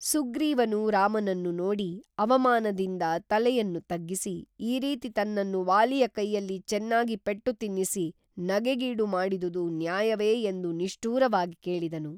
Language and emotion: Kannada, neutral